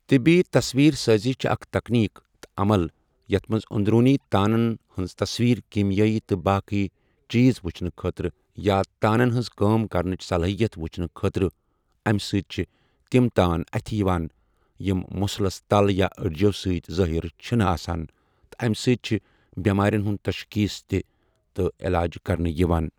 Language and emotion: Kashmiri, neutral